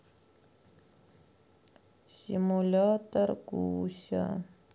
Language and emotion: Russian, sad